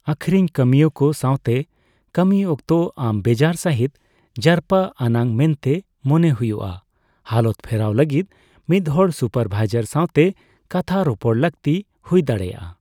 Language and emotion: Santali, neutral